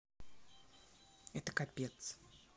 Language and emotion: Russian, neutral